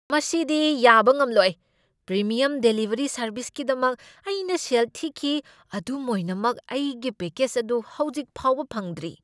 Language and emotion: Manipuri, angry